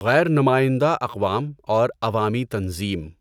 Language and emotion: Urdu, neutral